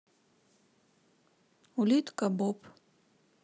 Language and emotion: Russian, neutral